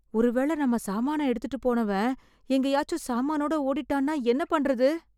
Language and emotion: Tamil, fearful